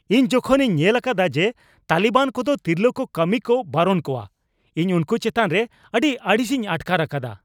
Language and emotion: Santali, angry